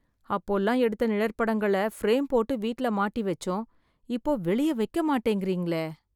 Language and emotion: Tamil, sad